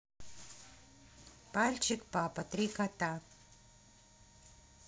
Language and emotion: Russian, neutral